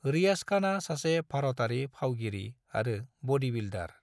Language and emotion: Bodo, neutral